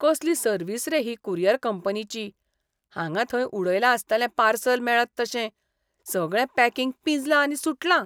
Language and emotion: Goan Konkani, disgusted